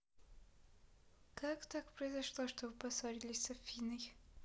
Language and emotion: Russian, neutral